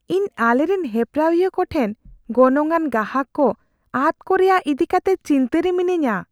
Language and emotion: Santali, fearful